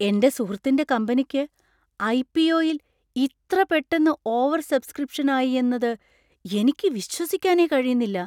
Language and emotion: Malayalam, surprised